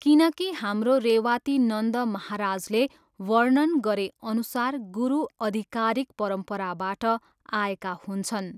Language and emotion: Nepali, neutral